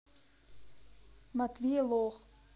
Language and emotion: Russian, neutral